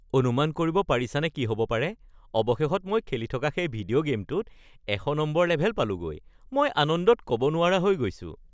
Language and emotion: Assamese, happy